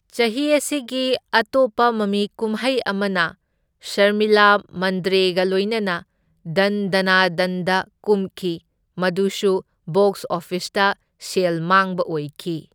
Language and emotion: Manipuri, neutral